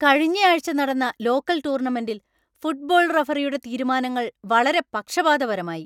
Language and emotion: Malayalam, angry